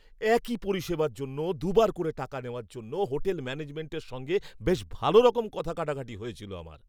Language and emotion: Bengali, angry